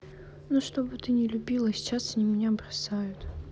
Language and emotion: Russian, sad